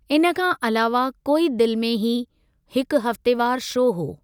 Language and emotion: Sindhi, neutral